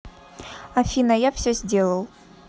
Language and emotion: Russian, neutral